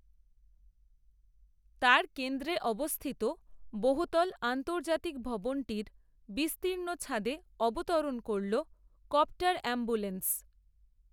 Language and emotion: Bengali, neutral